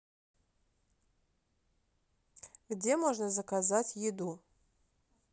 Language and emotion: Russian, neutral